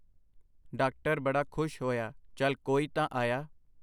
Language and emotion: Punjabi, neutral